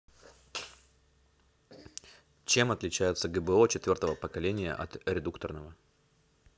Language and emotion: Russian, neutral